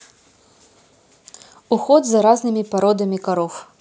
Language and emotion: Russian, neutral